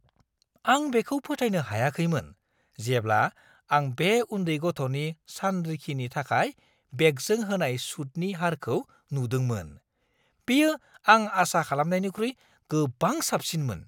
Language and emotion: Bodo, surprised